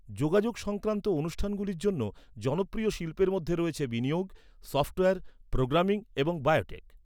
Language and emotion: Bengali, neutral